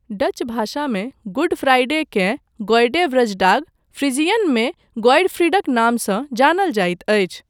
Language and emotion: Maithili, neutral